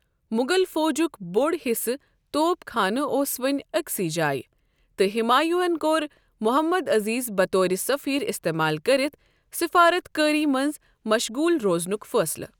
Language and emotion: Kashmiri, neutral